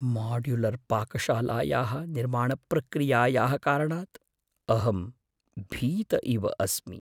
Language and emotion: Sanskrit, fearful